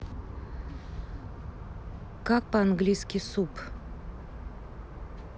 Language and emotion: Russian, neutral